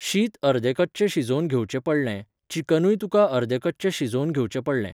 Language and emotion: Goan Konkani, neutral